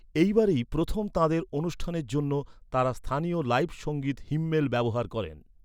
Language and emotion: Bengali, neutral